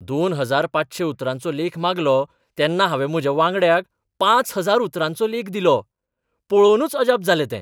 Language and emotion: Goan Konkani, surprised